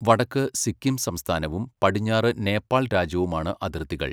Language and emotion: Malayalam, neutral